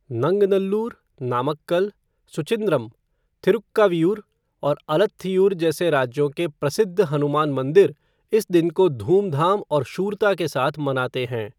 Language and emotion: Hindi, neutral